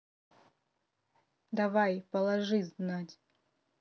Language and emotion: Russian, neutral